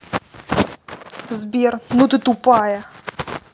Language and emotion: Russian, angry